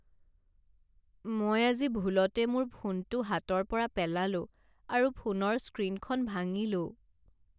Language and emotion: Assamese, sad